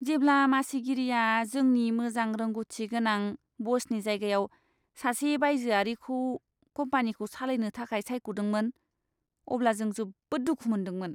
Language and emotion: Bodo, disgusted